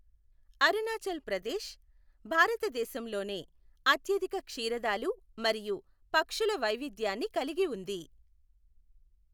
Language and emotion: Telugu, neutral